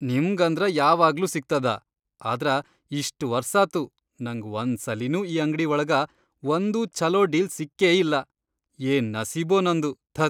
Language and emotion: Kannada, disgusted